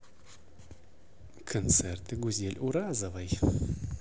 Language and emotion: Russian, positive